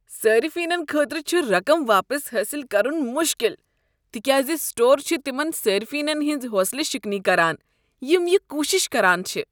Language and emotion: Kashmiri, disgusted